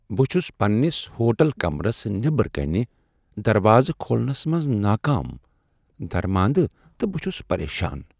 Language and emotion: Kashmiri, sad